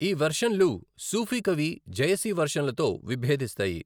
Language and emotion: Telugu, neutral